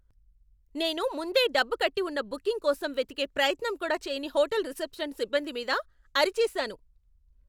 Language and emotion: Telugu, angry